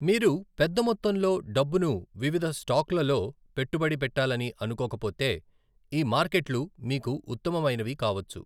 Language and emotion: Telugu, neutral